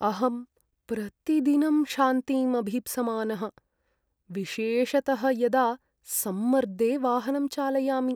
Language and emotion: Sanskrit, sad